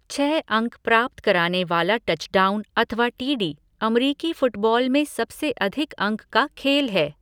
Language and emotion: Hindi, neutral